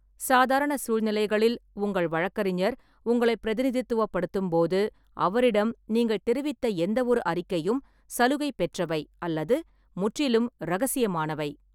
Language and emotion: Tamil, neutral